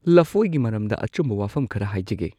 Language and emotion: Manipuri, neutral